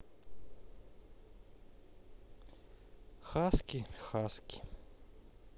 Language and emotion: Russian, neutral